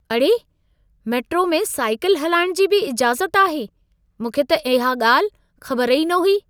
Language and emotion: Sindhi, surprised